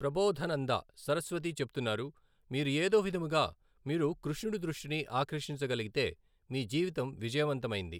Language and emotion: Telugu, neutral